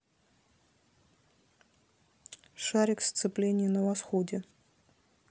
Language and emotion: Russian, neutral